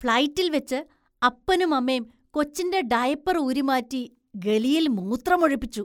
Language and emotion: Malayalam, disgusted